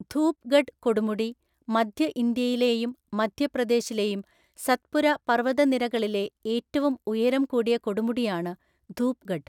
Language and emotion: Malayalam, neutral